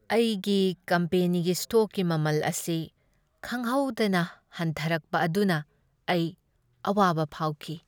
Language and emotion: Manipuri, sad